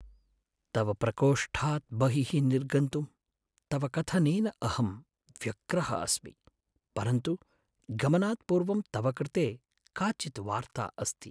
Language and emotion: Sanskrit, sad